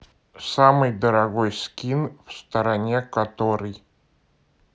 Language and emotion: Russian, neutral